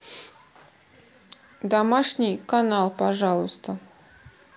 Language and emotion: Russian, neutral